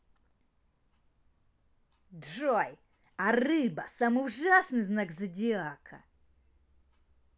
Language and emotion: Russian, angry